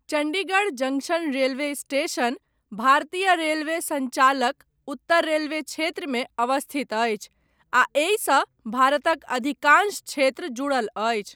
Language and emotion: Maithili, neutral